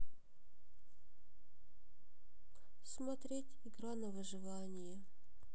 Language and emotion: Russian, sad